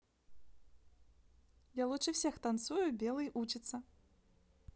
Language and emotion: Russian, neutral